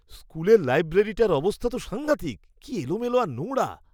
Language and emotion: Bengali, disgusted